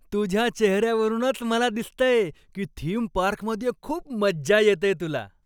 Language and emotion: Marathi, happy